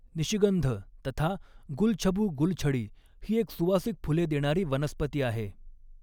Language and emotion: Marathi, neutral